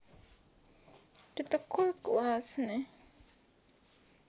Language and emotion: Russian, sad